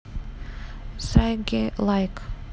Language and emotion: Russian, neutral